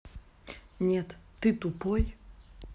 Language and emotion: Russian, angry